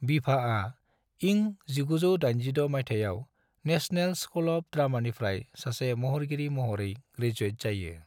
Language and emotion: Bodo, neutral